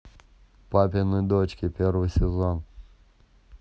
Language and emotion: Russian, neutral